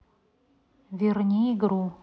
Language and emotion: Russian, neutral